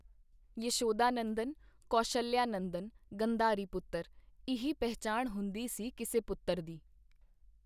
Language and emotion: Punjabi, neutral